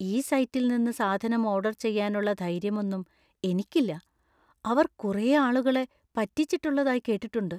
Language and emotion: Malayalam, fearful